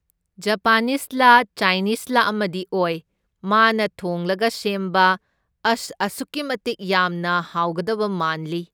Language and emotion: Manipuri, neutral